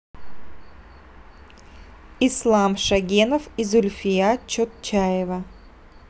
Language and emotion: Russian, neutral